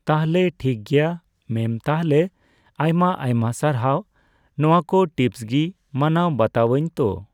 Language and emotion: Santali, neutral